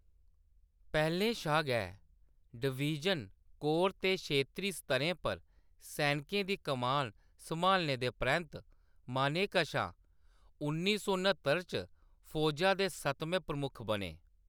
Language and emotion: Dogri, neutral